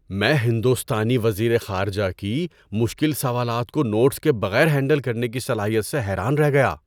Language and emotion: Urdu, surprised